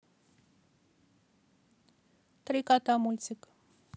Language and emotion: Russian, neutral